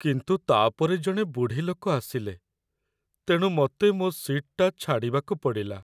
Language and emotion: Odia, sad